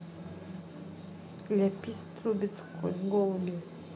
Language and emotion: Russian, neutral